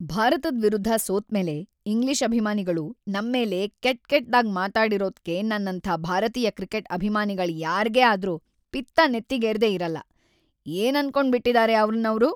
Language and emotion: Kannada, angry